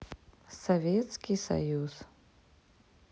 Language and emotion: Russian, neutral